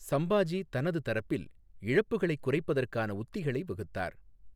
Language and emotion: Tamil, neutral